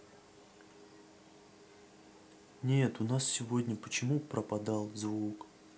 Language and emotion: Russian, sad